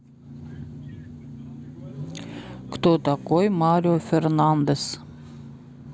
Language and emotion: Russian, neutral